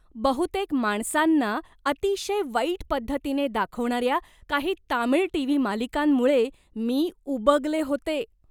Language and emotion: Marathi, disgusted